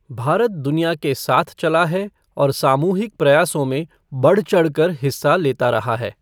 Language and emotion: Hindi, neutral